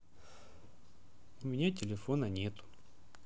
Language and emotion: Russian, sad